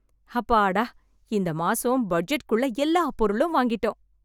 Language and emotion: Tamil, happy